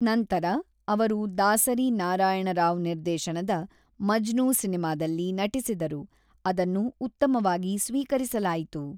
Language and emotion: Kannada, neutral